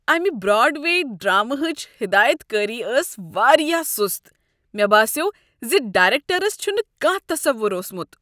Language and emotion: Kashmiri, disgusted